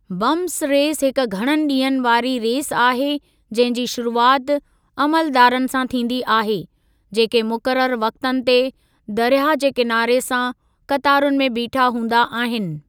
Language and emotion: Sindhi, neutral